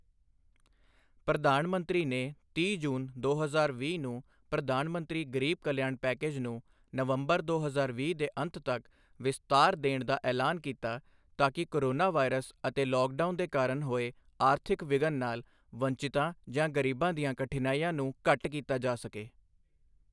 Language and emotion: Punjabi, neutral